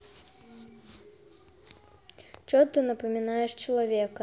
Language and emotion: Russian, neutral